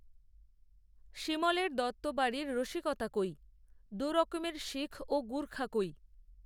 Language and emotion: Bengali, neutral